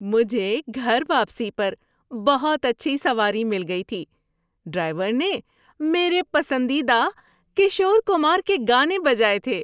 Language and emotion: Urdu, happy